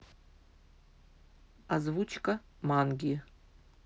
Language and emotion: Russian, neutral